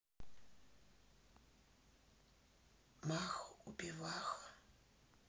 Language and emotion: Russian, neutral